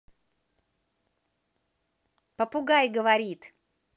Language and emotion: Russian, positive